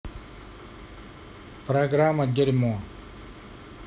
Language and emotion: Russian, neutral